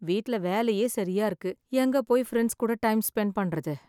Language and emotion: Tamil, sad